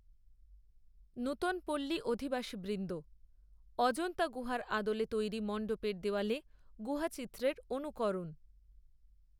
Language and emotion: Bengali, neutral